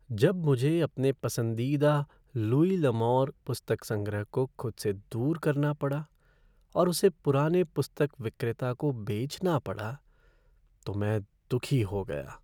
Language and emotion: Hindi, sad